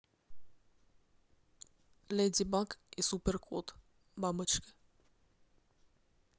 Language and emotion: Russian, neutral